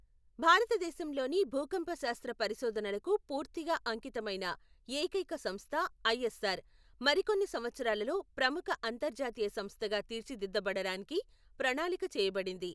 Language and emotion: Telugu, neutral